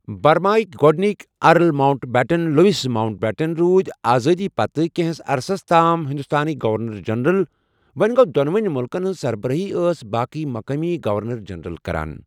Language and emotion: Kashmiri, neutral